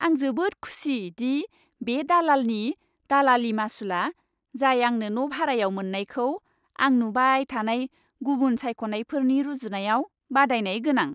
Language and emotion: Bodo, happy